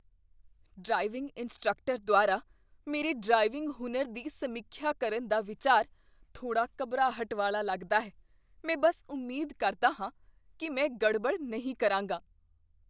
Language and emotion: Punjabi, fearful